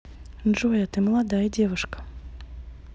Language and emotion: Russian, neutral